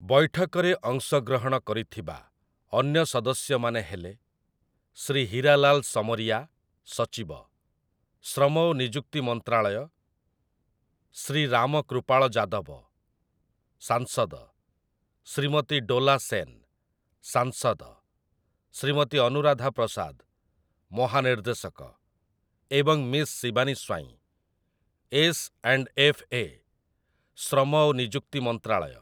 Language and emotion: Odia, neutral